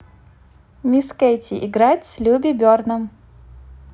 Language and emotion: Russian, positive